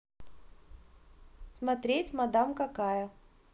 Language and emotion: Russian, neutral